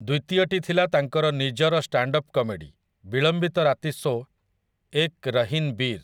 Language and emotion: Odia, neutral